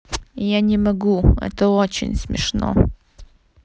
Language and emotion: Russian, neutral